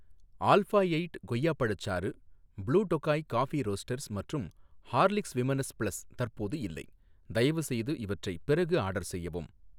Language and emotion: Tamil, neutral